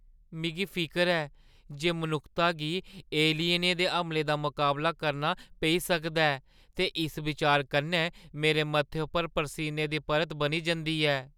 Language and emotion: Dogri, fearful